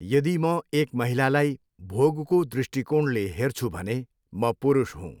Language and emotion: Nepali, neutral